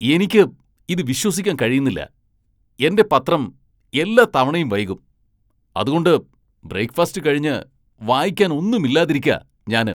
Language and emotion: Malayalam, angry